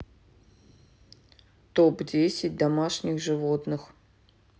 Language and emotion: Russian, neutral